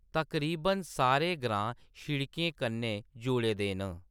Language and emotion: Dogri, neutral